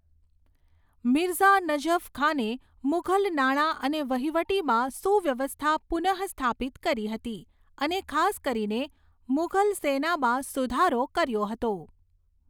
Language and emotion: Gujarati, neutral